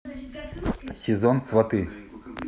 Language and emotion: Russian, neutral